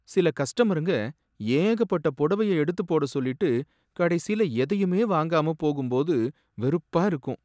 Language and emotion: Tamil, sad